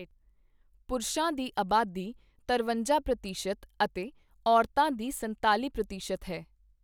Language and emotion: Punjabi, neutral